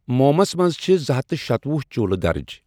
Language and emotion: Kashmiri, neutral